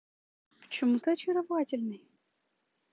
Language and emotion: Russian, positive